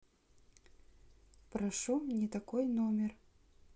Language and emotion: Russian, neutral